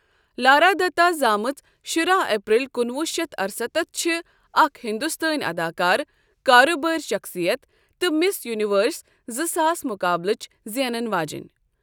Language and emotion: Kashmiri, neutral